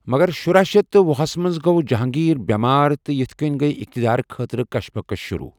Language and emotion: Kashmiri, neutral